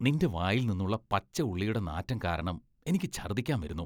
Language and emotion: Malayalam, disgusted